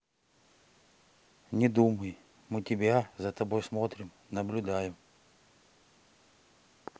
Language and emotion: Russian, neutral